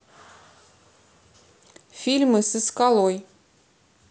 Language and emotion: Russian, neutral